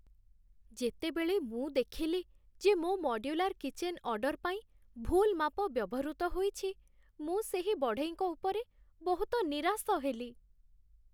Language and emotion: Odia, sad